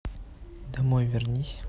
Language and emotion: Russian, neutral